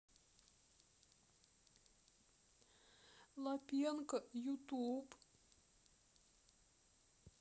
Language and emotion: Russian, sad